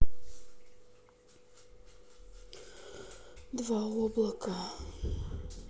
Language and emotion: Russian, sad